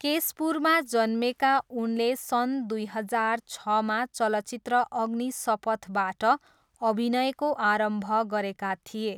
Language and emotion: Nepali, neutral